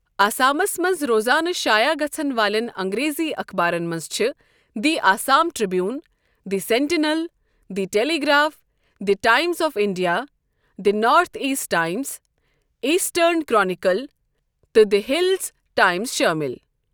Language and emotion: Kashmiri, neutral